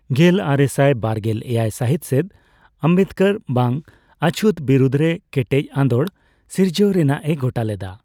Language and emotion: Santali, neutral